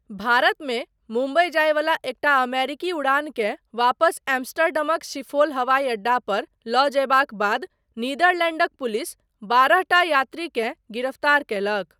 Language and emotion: Maithili, neutral